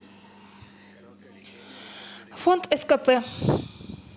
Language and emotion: Russian, angry